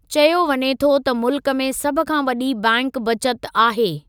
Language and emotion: Sindhi, neutral